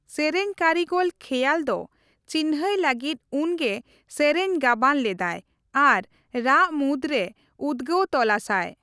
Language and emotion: Santali, neutral